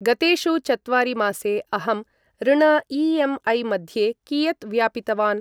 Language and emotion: Sanskrit, neutral